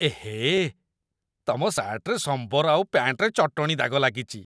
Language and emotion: Odia, disgusted